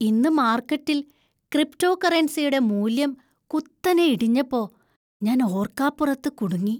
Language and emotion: Malayalam, surprised